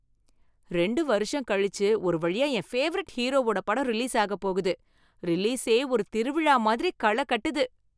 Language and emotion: Tamil, happy